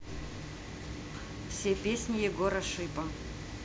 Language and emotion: Russian, neutral